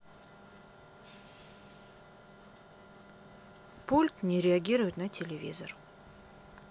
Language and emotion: Russian, neutral